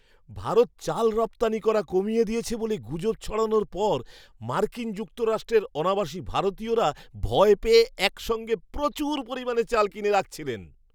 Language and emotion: Bengali, surprised